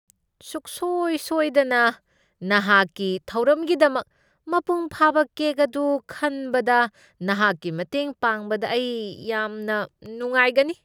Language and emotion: Manipuri, disgusted